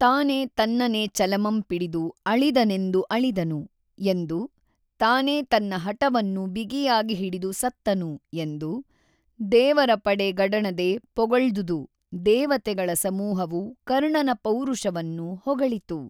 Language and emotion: Kannada, neutral